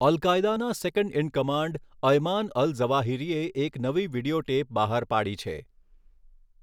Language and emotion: Gujarati, neutral